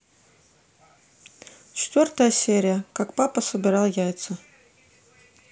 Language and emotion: Russian, neutral